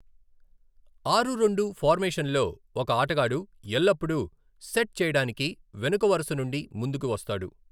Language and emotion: Telugu, neutral